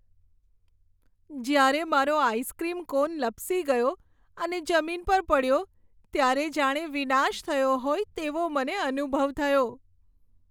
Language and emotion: Gujarati, sad